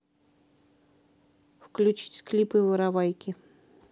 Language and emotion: Russian, neutral